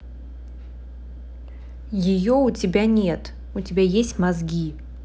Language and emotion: Russian, angry